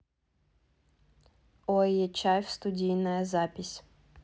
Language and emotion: Russian, neutral